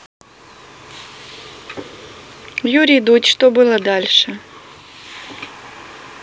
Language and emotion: Russian, neutral